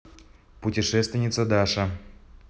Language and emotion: Russian, neutral